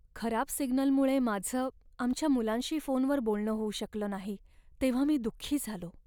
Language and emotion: Marathi, sad